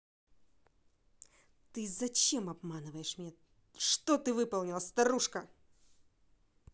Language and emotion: Russian, angry